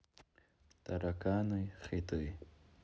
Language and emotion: Russian, neutral